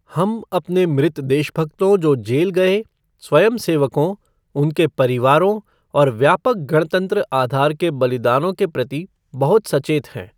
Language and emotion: Hindi, neutral